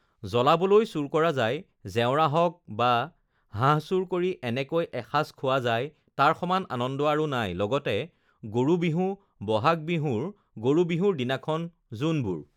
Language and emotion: Assamese, neutral